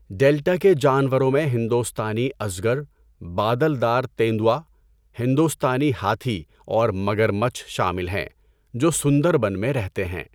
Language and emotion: Urdu, neutral